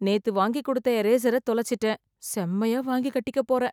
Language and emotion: Tamil, fearful